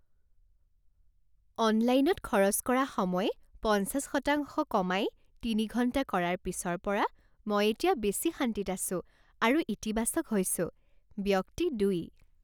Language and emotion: Assamese, happy